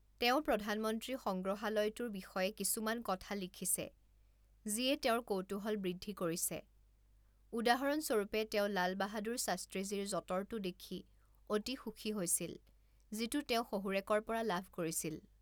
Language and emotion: Assamese, neutral